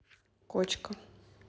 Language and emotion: Russian, neutral